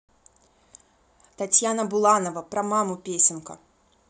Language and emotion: Russian, neutral